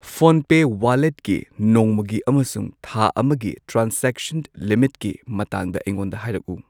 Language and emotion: Manipuri, neutral